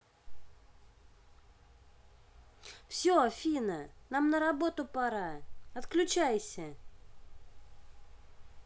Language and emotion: Russian, angry